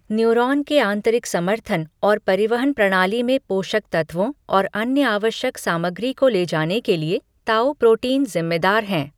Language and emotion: Hindi, neutral